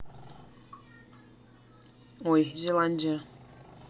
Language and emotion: Russian, neutral